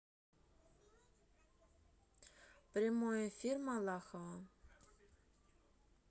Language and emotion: Russian, neutral